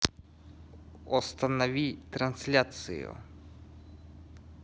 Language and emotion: Russian, neutral